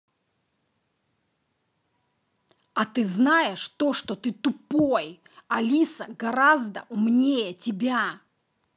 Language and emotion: Russian, angry